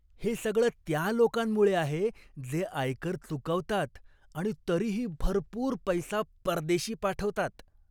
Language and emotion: Marathi, disgusted